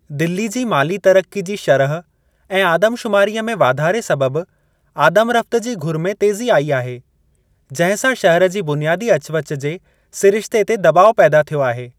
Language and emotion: Sindhi, neutral